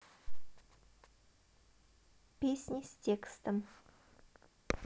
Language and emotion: Russian, neutral